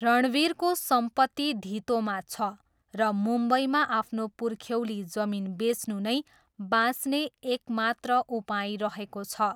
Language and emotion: Nepali, neutral